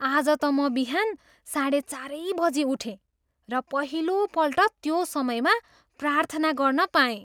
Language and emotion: Nepali, surprised